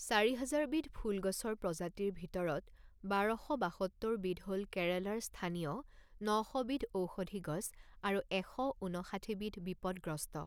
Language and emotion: Assamese, neutral